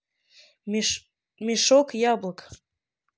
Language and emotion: Russian, neutral